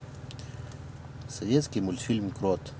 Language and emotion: Russian, neutral